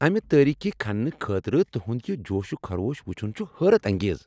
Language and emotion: Kashmiri, happy